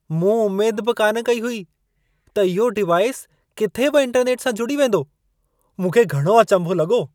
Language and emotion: Sindhi, surprised